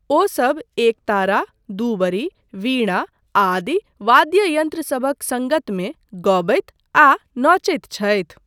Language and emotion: Maithili, neutral